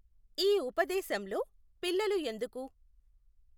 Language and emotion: Telugu, neutral